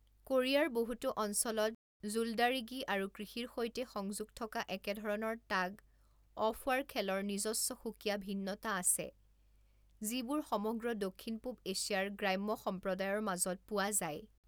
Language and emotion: Assamese, neutral